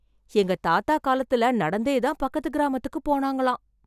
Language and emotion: Tamil, surprised